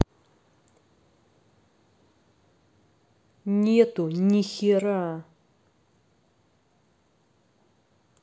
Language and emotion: Russian, angry